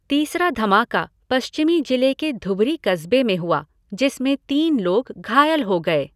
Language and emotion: Hindi, neutral